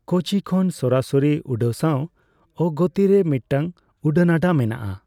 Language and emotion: Santali, neutral